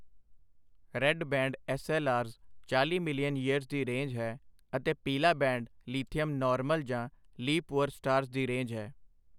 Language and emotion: Punjabi, neutral